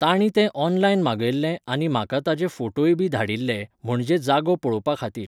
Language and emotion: Goan Konkani, neutral